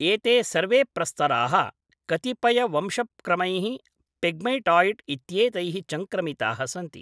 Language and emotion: Sanskrit, neutral